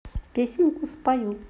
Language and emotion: Russian, positive